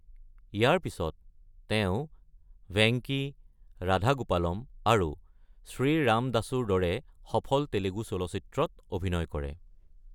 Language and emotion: Assamese, neutral